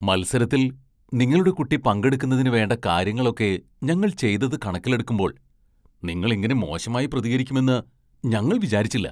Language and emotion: Malayalam, surprised